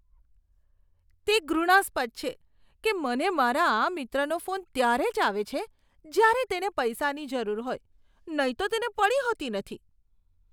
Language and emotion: Gujarati, disgusted